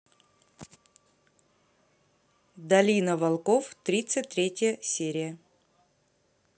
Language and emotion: Russian, neutral